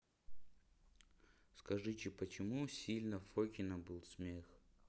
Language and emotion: Russian, neutral